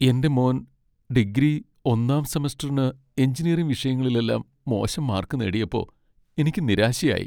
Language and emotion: Malayalam, sad